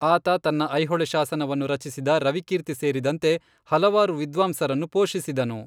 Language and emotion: Kannada, neutral